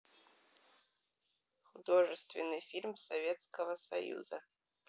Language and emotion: Russian, neutral